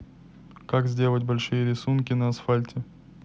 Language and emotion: Russian, neutral